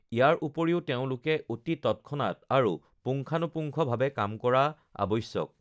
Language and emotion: Assamese, neutral